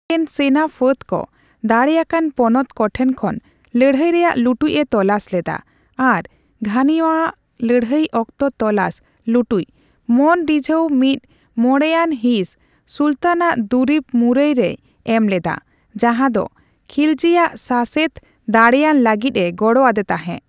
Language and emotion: Santali, neutral